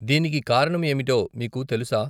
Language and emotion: Telugu, neutral